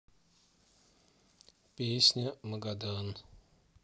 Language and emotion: Russian, neutral